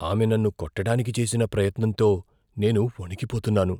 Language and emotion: Telugu, fearful